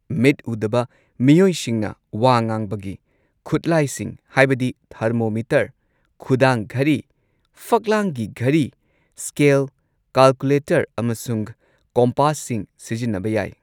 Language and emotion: Manipuri, neutral